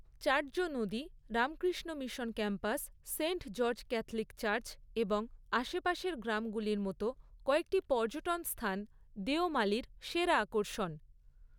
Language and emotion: Bengali, neutral